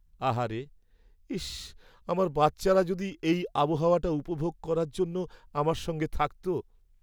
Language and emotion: Bengali, sad